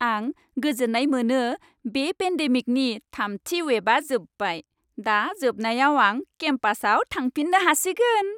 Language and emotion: Bodo, happy